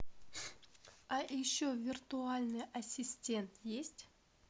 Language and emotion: Russian, neutral